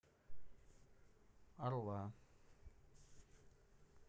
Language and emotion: Russian, neutral